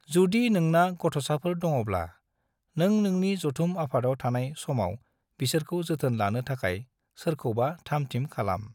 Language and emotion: Bodo, neutral